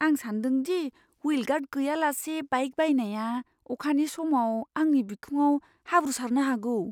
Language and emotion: Bodo, fearful